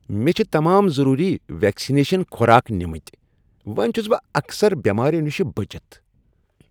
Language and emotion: Kashmiri, happy